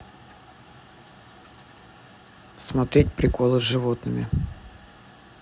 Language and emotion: Russian, neutral